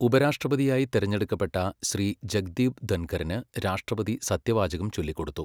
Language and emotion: Malayalam, neutral